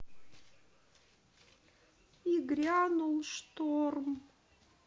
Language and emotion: Russian, sad